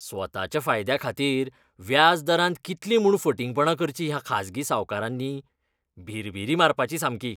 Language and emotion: Goan Konkani, disgusted